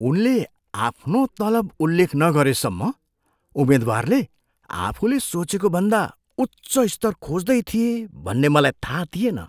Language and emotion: Nepali, surprised